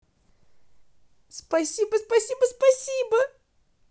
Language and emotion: Russian, positive